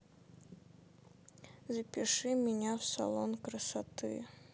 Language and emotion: Russian, sad